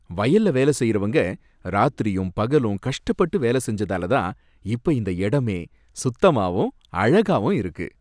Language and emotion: Tamil, happy